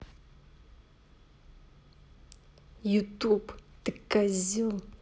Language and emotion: Russian, angry